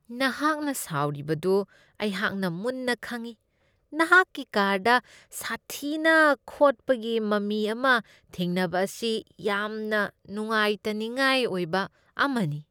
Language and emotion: Manipuri, disgusted